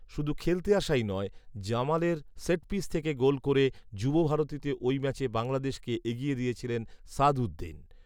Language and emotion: Bengali, neutral